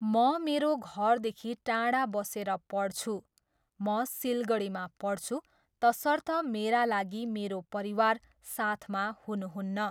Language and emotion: Nepali, neutral